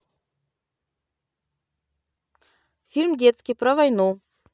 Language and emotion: Russian, positive